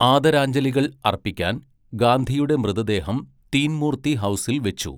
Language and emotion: Malayalam, neutral